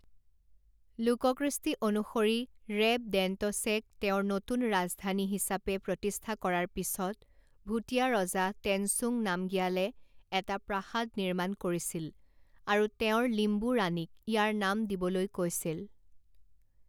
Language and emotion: Assamese, neutral